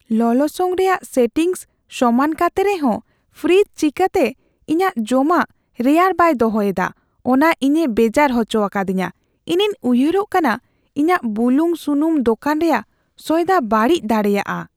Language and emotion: Santali, fearful